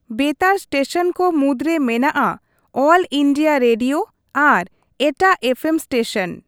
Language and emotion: Santali, neutral